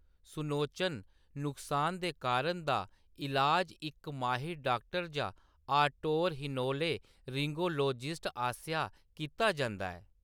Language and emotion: Dogri, neutral